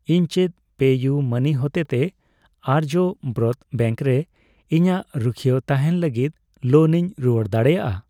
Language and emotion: Santali, neutral